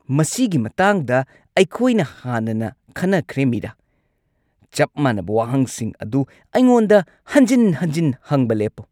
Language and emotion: Manipuri, angry